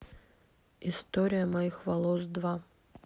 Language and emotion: Russian, neutral